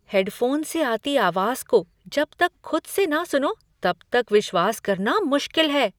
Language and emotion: Hindi, surprised